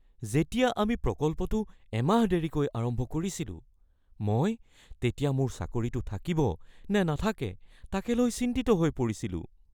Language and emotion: Assamese, fearful